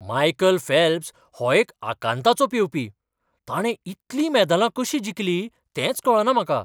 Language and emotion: Goan Konkani, surprised